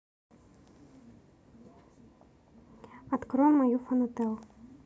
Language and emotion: Russian, neutral